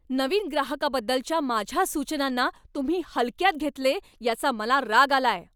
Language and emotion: Marathi, angry